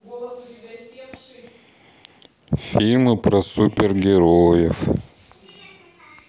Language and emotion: Russian, sad